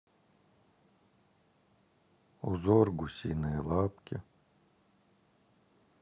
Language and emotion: Russian, sad